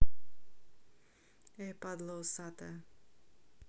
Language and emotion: Russian, angry